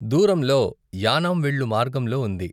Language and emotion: Telugu, neutral